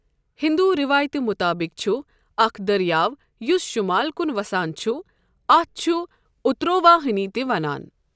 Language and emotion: Kashmiri, neutral